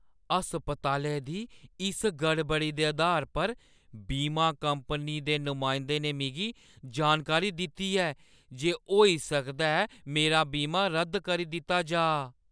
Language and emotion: Dogri, fearful